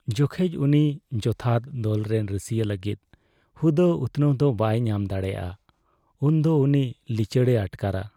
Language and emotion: Santali, sad